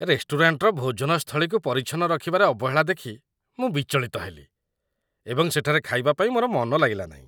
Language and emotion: Odia, disgusted